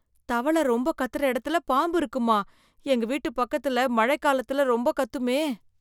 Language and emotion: Tamil, fearful